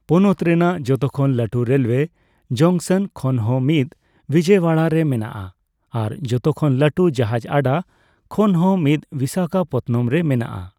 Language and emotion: Santali, neutral